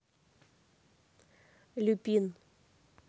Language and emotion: Russian, neutral